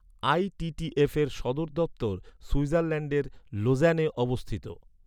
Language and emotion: Bengali, neutral